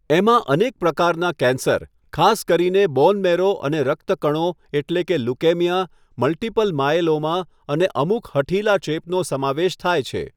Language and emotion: Gujarati, neutral